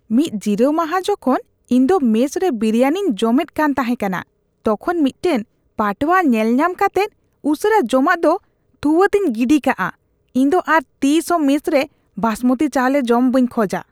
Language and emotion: Santali, disgusted